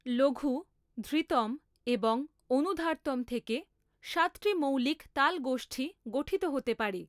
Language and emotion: Bengali, neutral